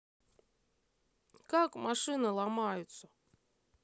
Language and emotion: Russian, sad